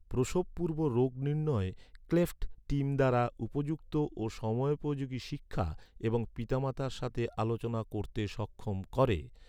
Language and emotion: Bengali, neutral